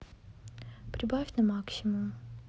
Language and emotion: Russian, neutral